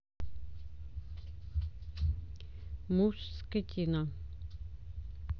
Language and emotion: Russian, neutral